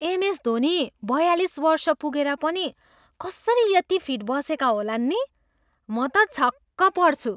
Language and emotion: Nepali, surprised